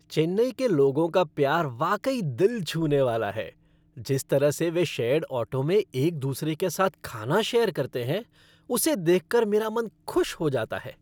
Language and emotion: Hindi, happy